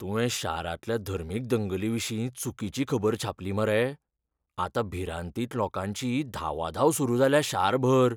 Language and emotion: Goan Konkani, fearful